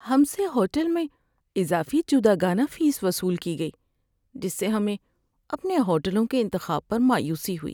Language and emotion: Urdu, sad